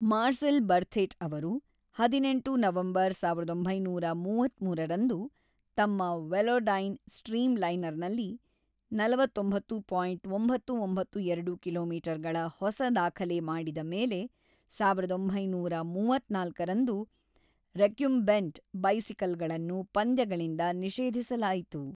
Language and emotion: Kannada, neutral